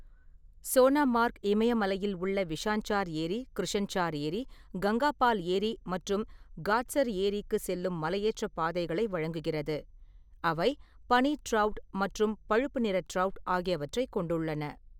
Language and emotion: Tamil, neutral